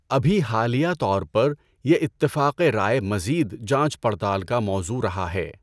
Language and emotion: Urdu, neutral